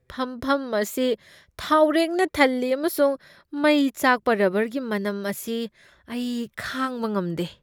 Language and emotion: Manipuri, disgusted